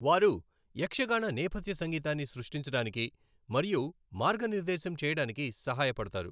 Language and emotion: Telugu, neutral